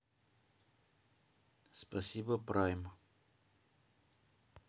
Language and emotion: Russian, neutral